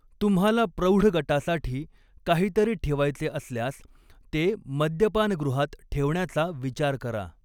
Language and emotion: Marathi, neutral